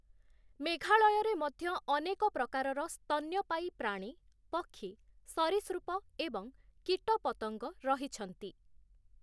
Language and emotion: Odia, neutral